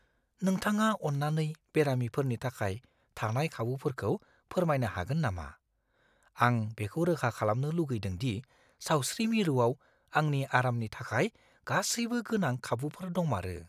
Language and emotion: Bodo, fearful